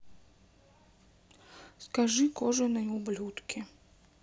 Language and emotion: Russian, sad